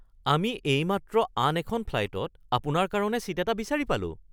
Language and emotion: Assamese, surprised